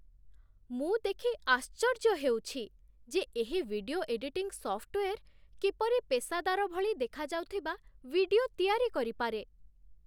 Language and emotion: Odia, surprised